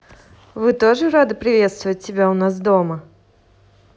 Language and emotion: Russian, positive